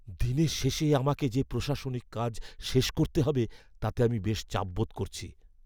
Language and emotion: Bengali, fearful